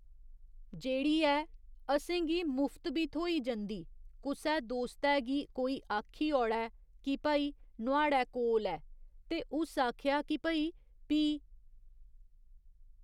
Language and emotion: Dogri, neutral